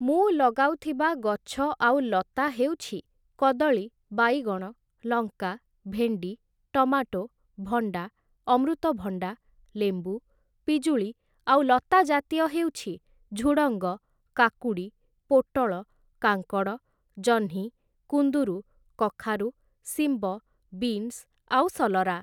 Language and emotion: Odia, neutral